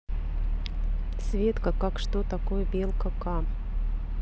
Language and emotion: Russian, neutral